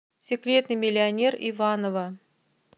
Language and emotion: Russian, neutral